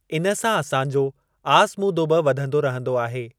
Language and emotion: Sindhi, neutral